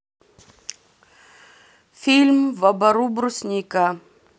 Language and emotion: Russian, neutral